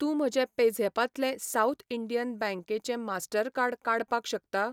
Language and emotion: Goan Konkani, neutral